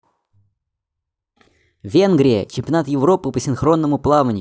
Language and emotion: Russian, neutral